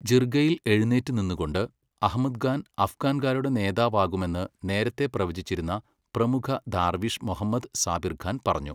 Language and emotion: Malayalam, neutral